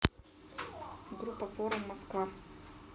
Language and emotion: Russian, neutral